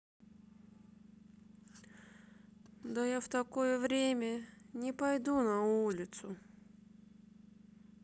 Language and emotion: Russian, sad